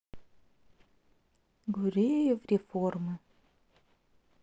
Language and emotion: Russian, sad